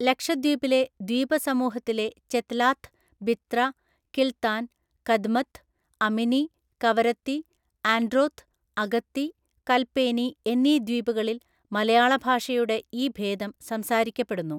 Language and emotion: Malayalam, neutral